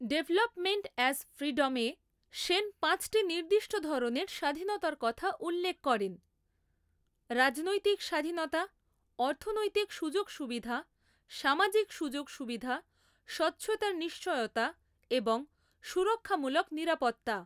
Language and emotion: Bengali, neutral